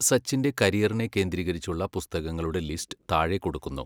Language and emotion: Malayalam, neutral